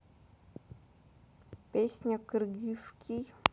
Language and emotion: Russian, neutral